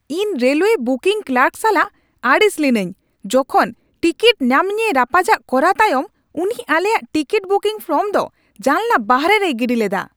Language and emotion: Santali, angry